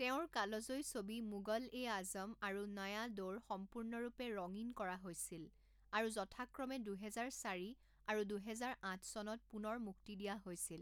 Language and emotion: Assamese, neutral